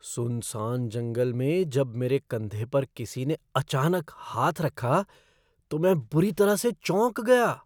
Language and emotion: Hindi, surprised